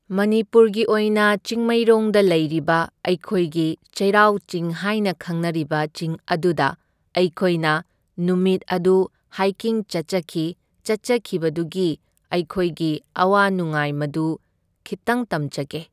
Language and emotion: Manipuri, neutral